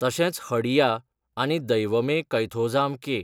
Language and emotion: Goan Konkani, neutral